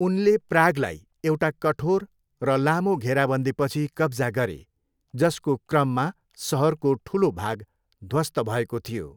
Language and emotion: Nepali, neutral